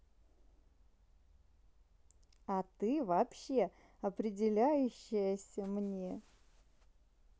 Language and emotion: Russian, positive